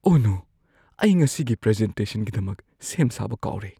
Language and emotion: Manipuri, fearful